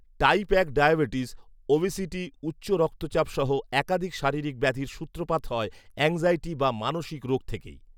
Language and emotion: Bengali, neutral